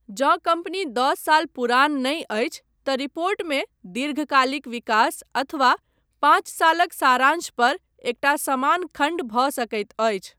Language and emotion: Maithili, neutral